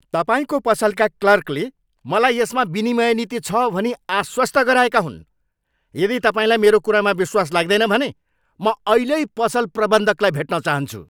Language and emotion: Nepali, angry